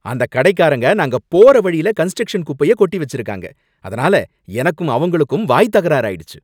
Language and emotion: Tamil, angry